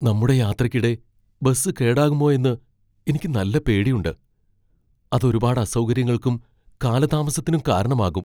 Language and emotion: Malayalam, fearful